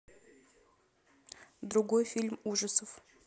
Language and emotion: Russian, neutral